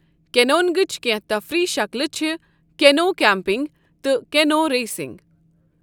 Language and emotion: Kashmiri, neutral